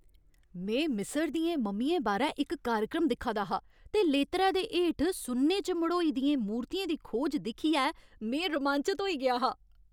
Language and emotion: Dogri, happy